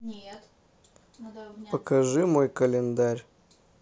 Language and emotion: Russian, neutral